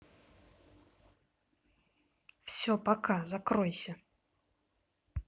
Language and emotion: Russian, angry